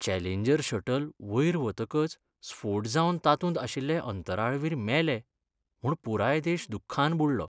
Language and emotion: Goan Konkani, sad